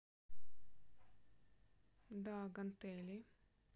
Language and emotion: Russian, neutral